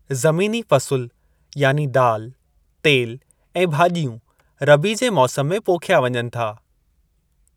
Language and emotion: Sindhi, neutral